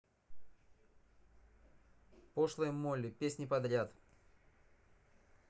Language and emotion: Russian, neutral